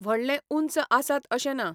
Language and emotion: Goan Konkani, neutral